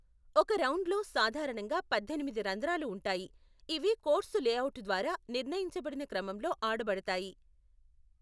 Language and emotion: Telugu, neutral